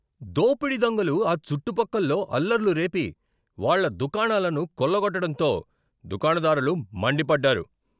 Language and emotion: Telugu, angry